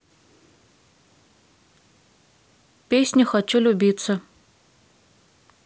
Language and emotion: Russian, neutral